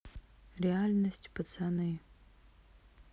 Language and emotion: Russian, sad